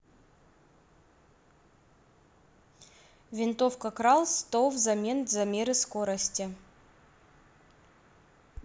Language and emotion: Russian, neutral